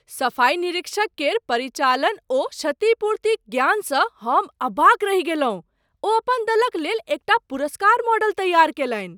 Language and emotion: Maithili, surprised